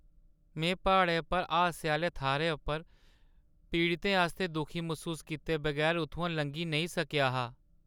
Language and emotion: Dogri, sad